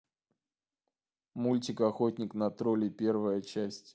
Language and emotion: Russian, neutral